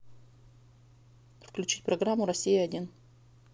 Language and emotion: Russian, neutral